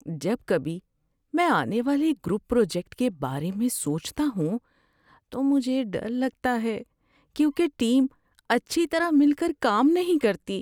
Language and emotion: Urdu, fearful